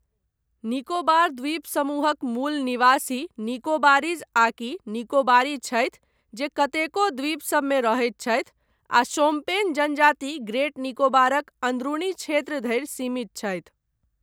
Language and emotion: Maithili, neutral